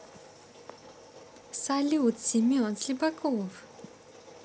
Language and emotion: Russian, positive